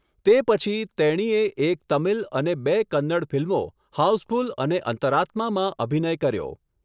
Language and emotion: Gujarati, neutral